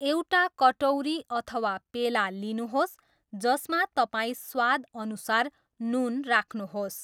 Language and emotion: Nepali, neutral